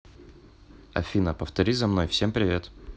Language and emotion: Russian, neutral